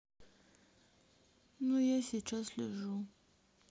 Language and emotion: Russian, sad